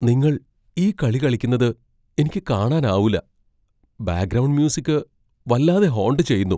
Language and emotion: Malayalam, fearful